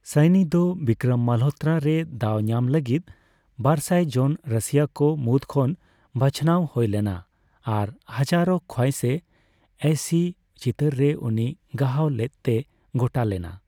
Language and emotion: Santali, neutral